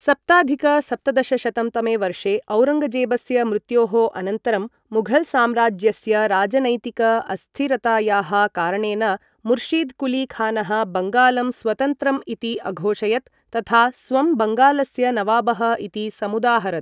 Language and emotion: Sanskrit, neutral